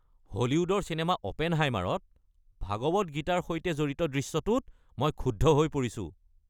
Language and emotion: Assamese, angry